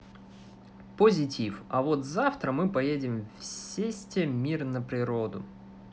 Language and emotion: Russian, positive